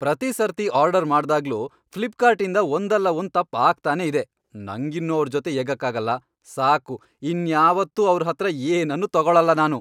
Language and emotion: Kannada, angry